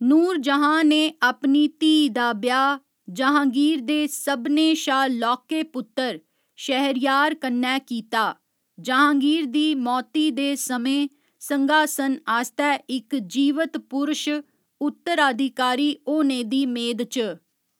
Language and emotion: Dogri, neutral